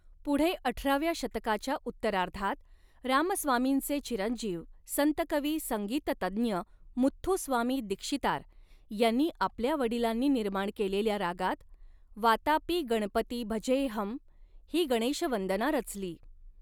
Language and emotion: Marathi, neutral